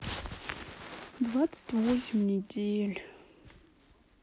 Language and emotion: Russian, sad